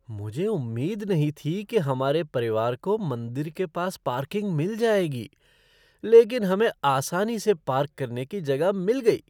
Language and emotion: Hindi, surprised